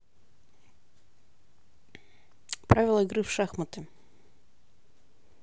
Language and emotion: Russian, neutral